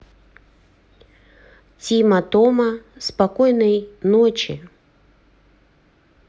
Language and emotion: Russian, neutral